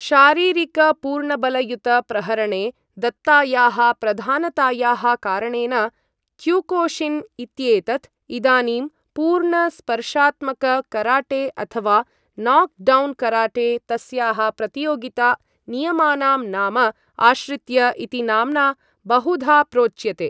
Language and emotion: Sanskrit, neutral